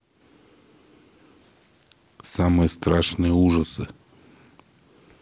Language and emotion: Russian, neutral